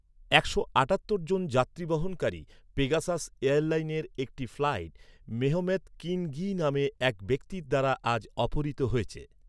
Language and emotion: Bengali, neutral